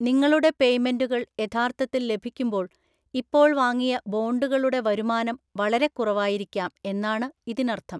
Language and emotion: Malayalam, neutral